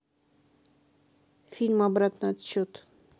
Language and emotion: Russian, neutral